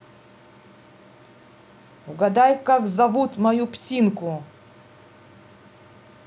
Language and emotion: Russian, angry